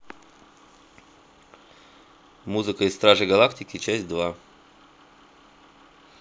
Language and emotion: Russian, neutral